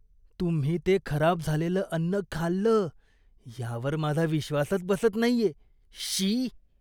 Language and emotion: Marathi, disgusted